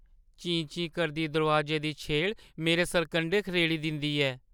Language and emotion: Dogri, fearful